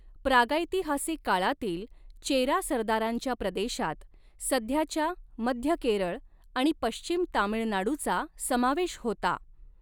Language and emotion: Marathi, neutral